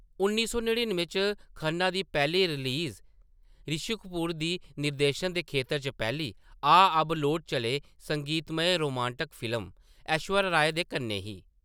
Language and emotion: Dogri, neutral